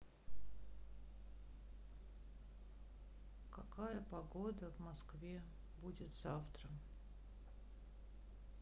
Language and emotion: Russian, sad